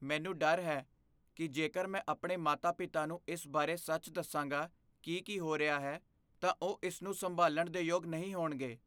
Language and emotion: Punjabi, fearful